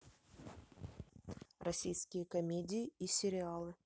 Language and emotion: Russian, neutral